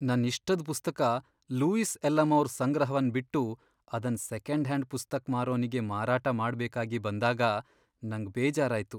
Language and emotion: Kannada, sad